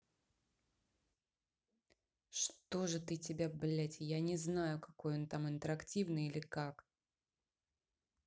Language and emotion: Russian, angry